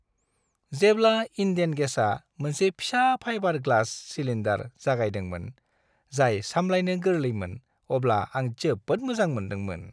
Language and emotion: Bodo, happy